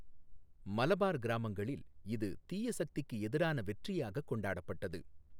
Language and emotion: Tamil, neutral